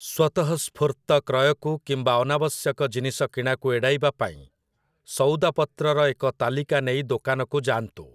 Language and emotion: Odia, neutral